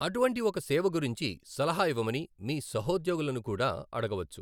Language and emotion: Telugu, neutral